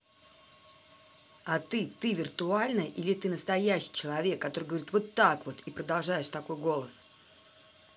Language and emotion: Russian, angry